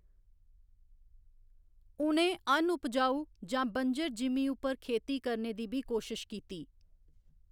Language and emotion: Dogri, neutral